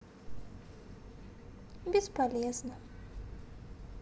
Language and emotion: Russian, sad